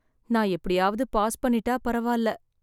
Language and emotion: Tamil, sad